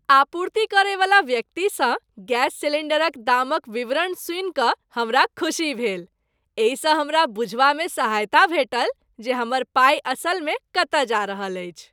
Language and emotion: Maithili, happy